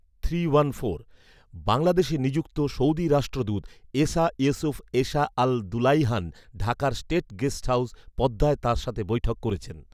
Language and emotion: Bengali, neutral